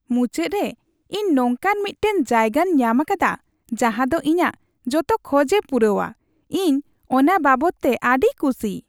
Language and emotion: Santali, happy